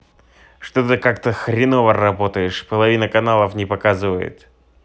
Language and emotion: Russian, angry